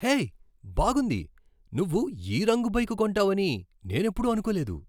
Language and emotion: Telugu, surprised